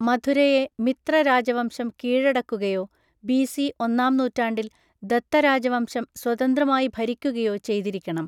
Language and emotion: Malayalam, neutral